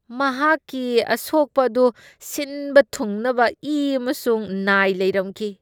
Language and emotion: Manipuri, disgusted